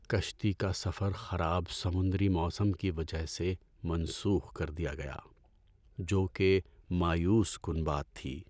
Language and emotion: Urdu, sad